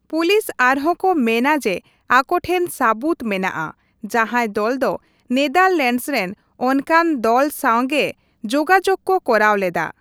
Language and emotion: Santali, neutral